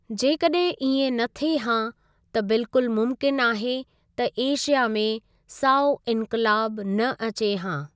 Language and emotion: Sindhi, neutral